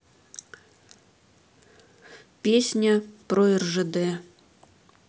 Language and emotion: Russian, neutral